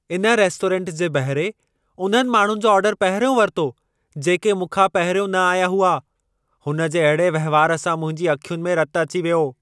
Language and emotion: Sindhi, angry